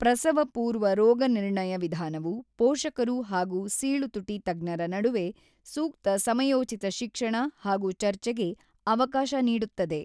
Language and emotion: Kannada, neutral